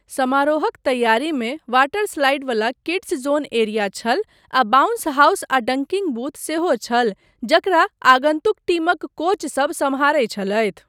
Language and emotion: Maithili, neutral